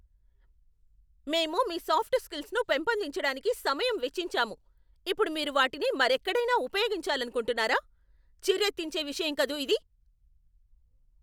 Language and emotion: Telugu, angry